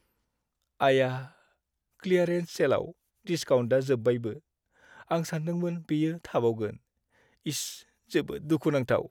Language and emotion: Bodo, sad